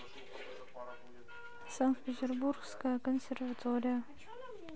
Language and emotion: Russian, neutral